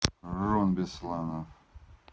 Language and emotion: Russian, neutral